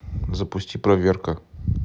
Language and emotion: Russian, neutral